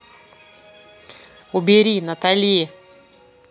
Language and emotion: Russian, angry